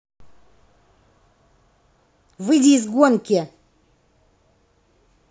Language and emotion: Russian, angry